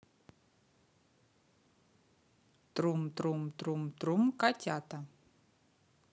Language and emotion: Russian, positive